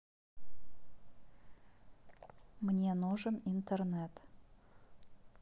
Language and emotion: Russian, neutral